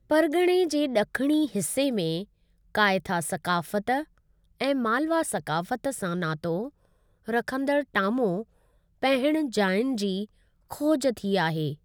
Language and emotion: Sindhi, neutral